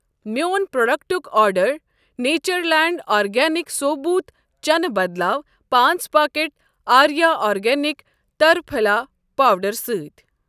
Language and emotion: Kashmiri, neutral